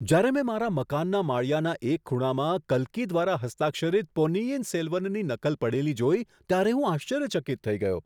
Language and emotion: Gujarati, surprised